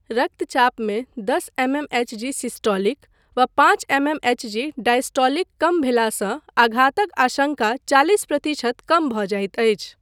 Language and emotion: Maithili, neutral